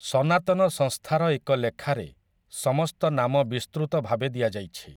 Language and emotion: Odia, neutral